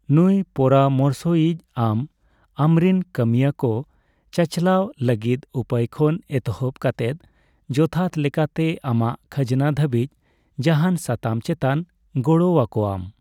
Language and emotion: Santali, neutral